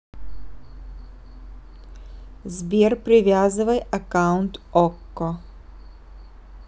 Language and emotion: Russian, neutral